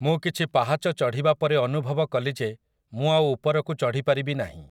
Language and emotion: Odia, neutral